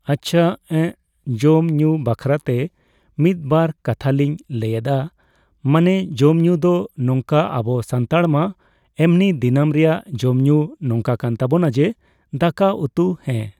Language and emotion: Santali, neutral